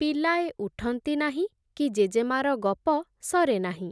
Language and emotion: Odia, neutral